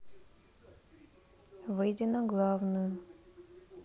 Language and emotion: Russian, neutral